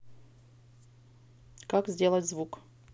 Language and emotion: Russian, neutral